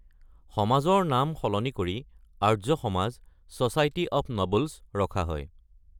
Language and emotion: Assamese, neutral